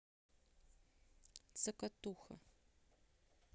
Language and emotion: Russian, neutral